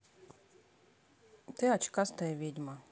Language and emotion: Russian, neutral